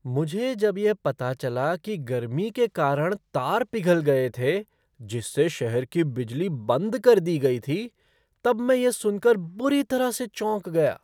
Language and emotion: Hindi, surprised